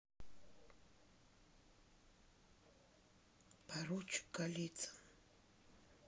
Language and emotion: Russian, neutral